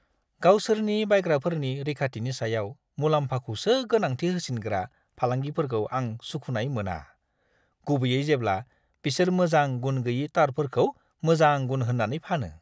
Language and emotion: Bodo, disgusted